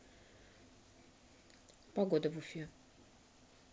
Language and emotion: Russian, neutral